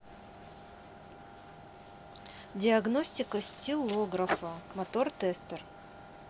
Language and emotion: Russian, neutral